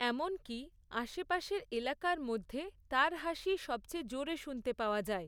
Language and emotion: Bengali, neutral